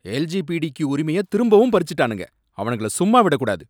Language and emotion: Tamil, angry